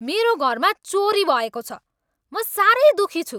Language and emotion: Nepali, angry